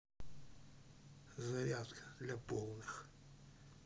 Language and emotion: Russian, neutral